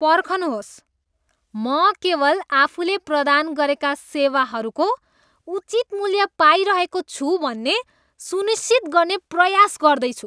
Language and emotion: Nepali, disgusted